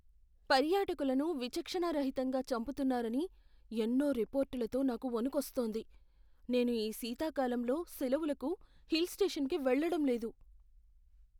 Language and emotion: Telugu, fearful